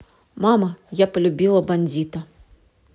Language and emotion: Russian, neutral